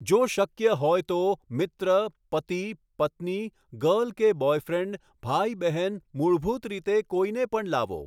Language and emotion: Gujarati, neutral